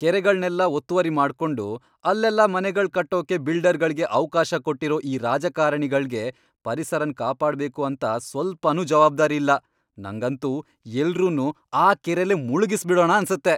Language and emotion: Kannada, angry